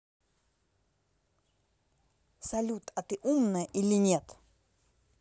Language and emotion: Russian, angry